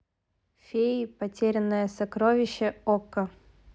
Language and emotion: Russian, neutral